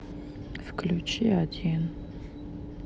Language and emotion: Russian, sad